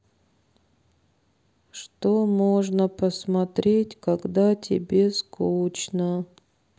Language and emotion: Russian, sad